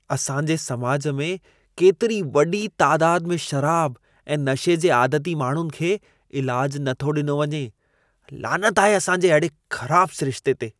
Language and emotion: Sindhi, disgusted